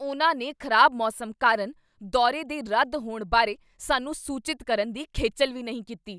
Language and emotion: Punjabi, angry